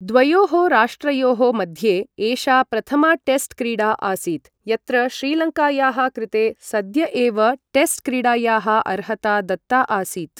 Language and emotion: Sanskrit, neutral